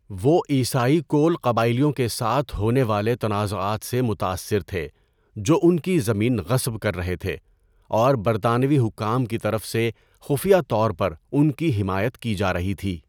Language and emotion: Urdu, neutral